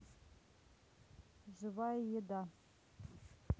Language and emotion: Russian, neutral